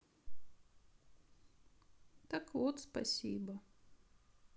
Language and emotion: Russian, sad